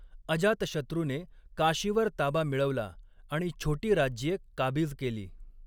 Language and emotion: Marathi, neutral